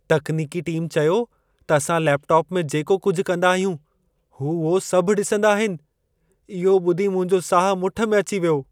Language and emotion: Sindhi, fearful